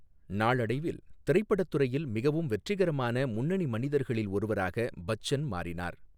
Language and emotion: Tamil, neutral